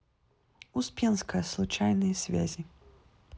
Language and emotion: Russian, neutral